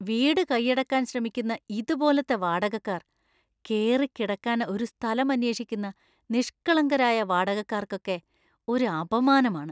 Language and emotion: Malayalam, disgusted